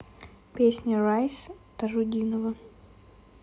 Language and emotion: Russian, neutral